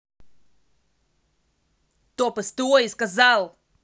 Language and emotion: Russian, angry